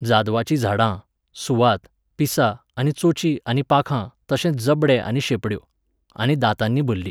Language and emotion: Goan Konkani, neutral